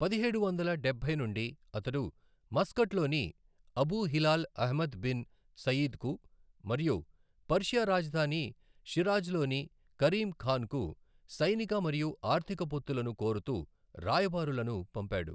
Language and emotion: Telugu, neutral